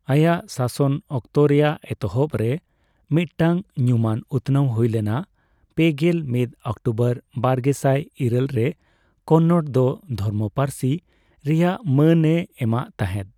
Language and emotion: Santali, neutral